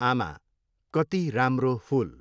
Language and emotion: Nepali, neutral